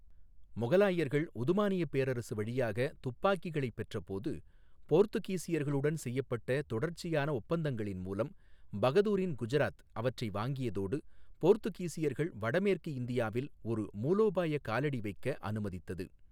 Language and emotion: Tamil, neutral